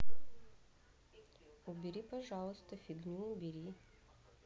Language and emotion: Russian, neutral